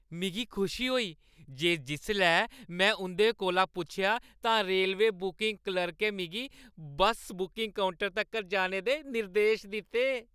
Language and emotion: Dogri, happy